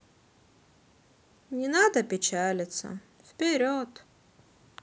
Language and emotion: Russian, sad